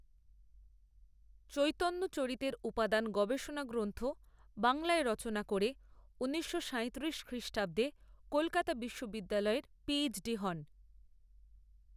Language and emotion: Bengali, neutral